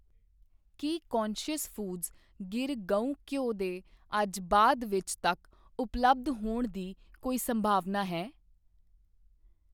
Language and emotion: Punjabi, neutral